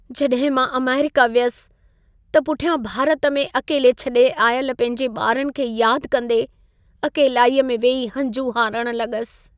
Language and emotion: Sindhi, sad